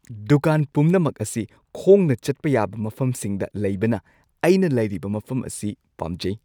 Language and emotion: Manipuri, happy